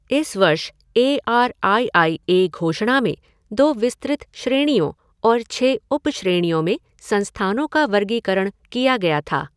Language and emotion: Hindi, neutral